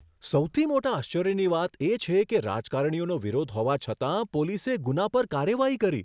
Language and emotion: Gujarati, surprised